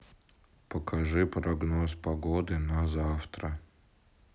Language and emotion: Russian, sad